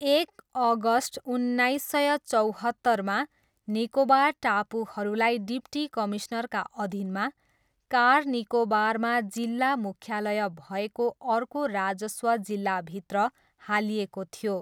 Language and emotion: Nepali, neutral